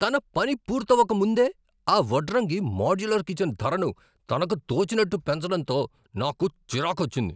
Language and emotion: Telugu, angry